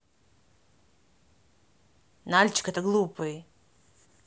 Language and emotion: Russian, angry